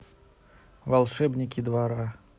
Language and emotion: Russian, neutral